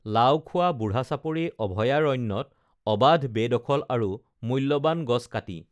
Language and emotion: Assamese, neutral